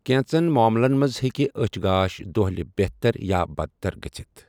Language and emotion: Kashmiri, neutral